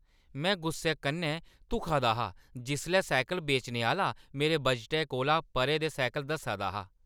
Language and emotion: Dogri, angry